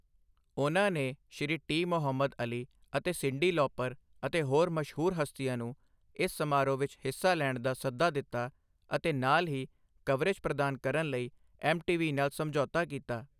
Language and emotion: Punjabi, neutral